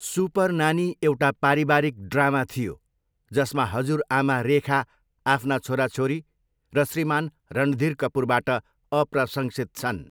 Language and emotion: Nepali, neutral